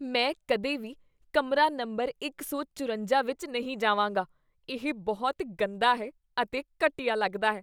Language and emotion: Punjabi, disgusted